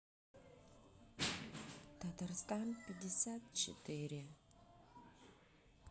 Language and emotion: Russian, sad